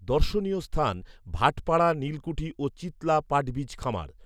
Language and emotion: Bengali, neutral